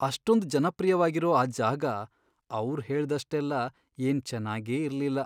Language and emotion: Kannada, sad